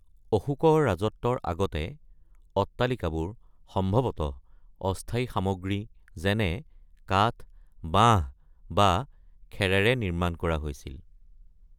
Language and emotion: Assamese, neutral